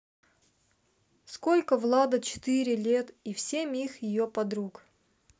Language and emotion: Russian, neutral